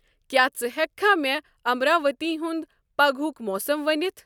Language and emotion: Kashmiri, neutral